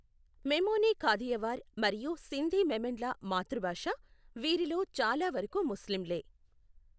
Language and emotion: Telugu, neutral